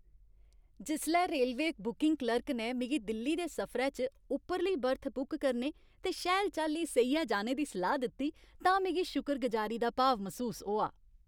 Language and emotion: Dogri, happy